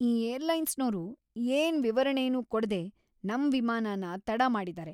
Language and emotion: Kannada, angry